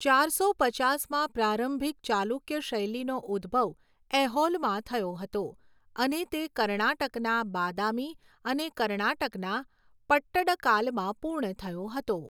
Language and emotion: Gujarati, neutral